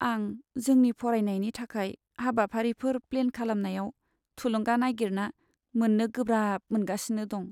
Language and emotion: Bodo, sad